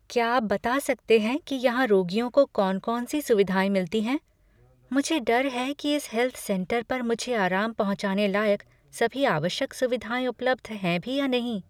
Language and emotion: Hindi, fearful